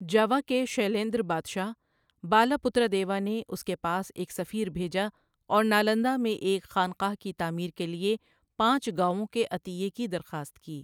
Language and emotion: Urdu, neutral